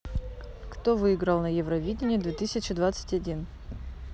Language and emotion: Russian, neutral